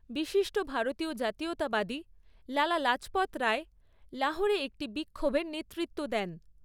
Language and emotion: Bengali, neutral